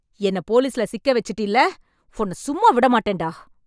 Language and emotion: Tamil, angry